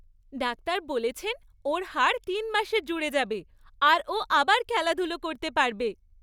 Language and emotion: Bengali, happy